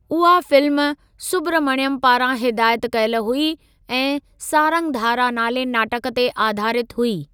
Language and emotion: Sindhi, neutral